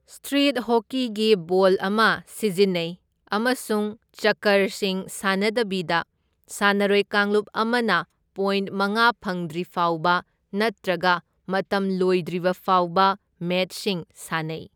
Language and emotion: Manipuri, neutral